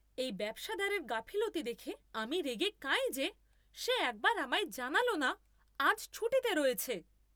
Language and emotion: Bengali, angry